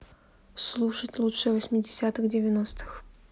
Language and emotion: Russian, neutral